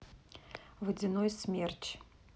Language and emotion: Russian, neutral